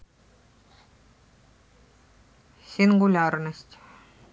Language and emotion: Russian, neutral